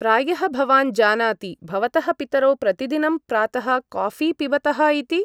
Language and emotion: Sanskrit, neutral